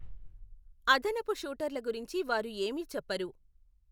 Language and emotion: Telugu, neutral